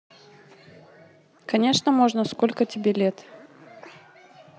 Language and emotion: Russian, neutral